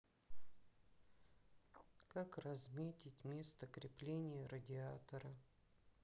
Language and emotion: Russian, sad